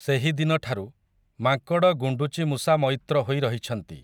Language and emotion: Odia, neutral